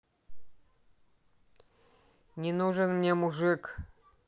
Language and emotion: Russian, angry